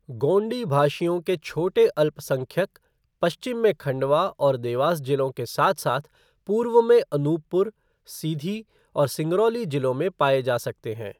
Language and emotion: Hindi, neutral